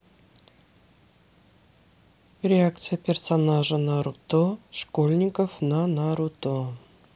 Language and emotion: Russian, neutral